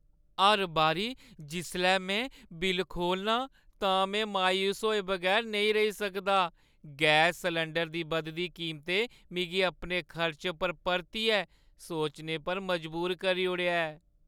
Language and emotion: Dogri, sad